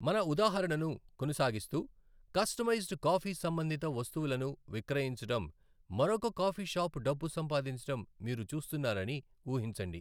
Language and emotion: Telugu, neutral